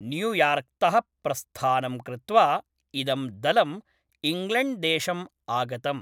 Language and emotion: Sanskrit, neutral